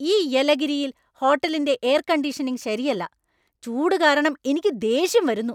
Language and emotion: Malayalam, angry